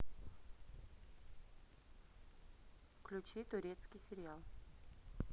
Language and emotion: Russian, neutral